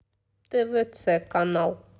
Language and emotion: Russian, neutral